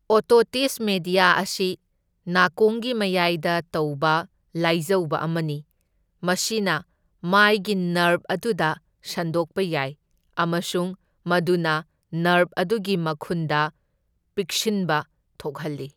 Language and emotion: Manipuri, neutral